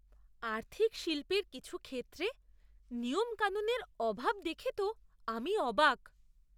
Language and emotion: Bengali, surprised